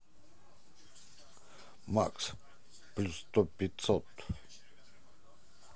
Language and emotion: Russian, positive